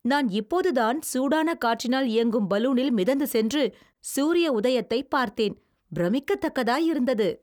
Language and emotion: Tamil, happy